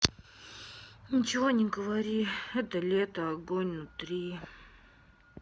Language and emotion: Russian, sad